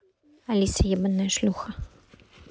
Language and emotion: Russian, neutral